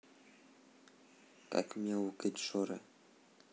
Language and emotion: Russian, neutral